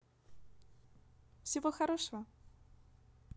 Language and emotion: Russian, positive